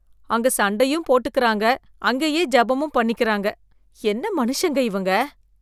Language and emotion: Tamil, disgusted